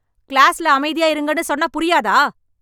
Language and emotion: Tamil, angry